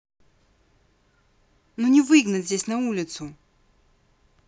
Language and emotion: Russian, angry